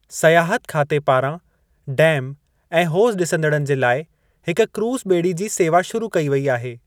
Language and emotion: Sindhi, neutral